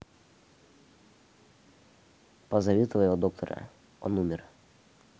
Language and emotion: Russian, neutral